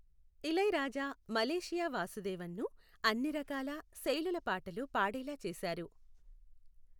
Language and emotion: Telugu, neutral